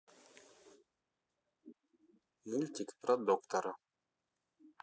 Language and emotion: Russian, neutral